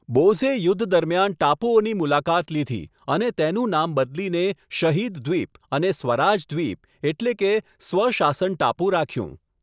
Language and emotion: Gujarati, neutral